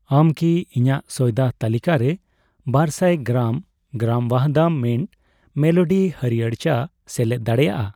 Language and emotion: Santali, neutral